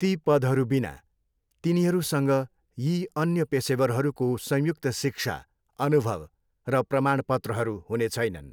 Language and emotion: Nepali, neutral